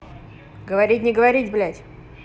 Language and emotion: Russian, neutral